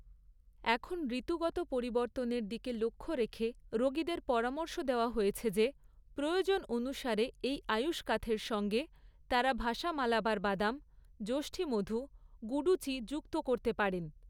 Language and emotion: Bengali, neutral